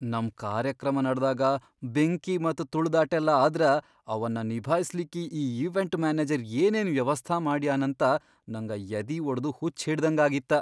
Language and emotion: Kannada, fearful